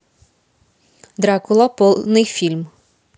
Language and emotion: Russian, positive